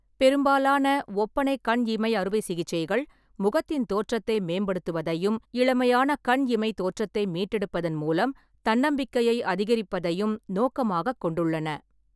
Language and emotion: Tamil, neutral